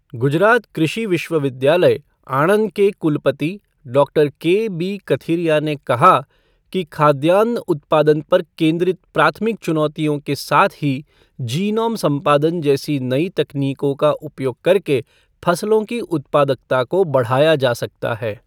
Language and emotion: Hindi, neutral